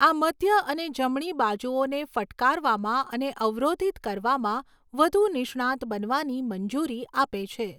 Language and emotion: Gujarati, neutral